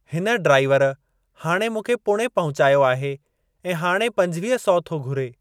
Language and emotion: Sindhi, neutral